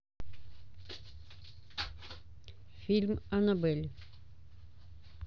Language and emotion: Russian, neutral